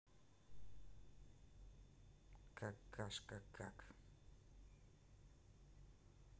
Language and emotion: Russian, neutral